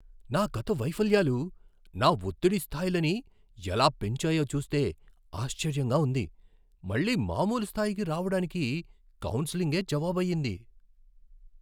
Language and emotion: Telugu, surprised